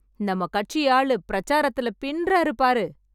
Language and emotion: Tamil, happy